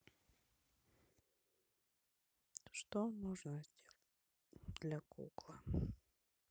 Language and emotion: Russian, sad